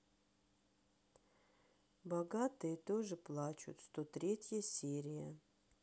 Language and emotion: Russian, sad